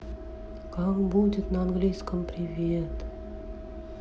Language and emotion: Russian, sad